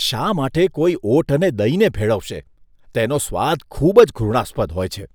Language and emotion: Gujarati, disgusted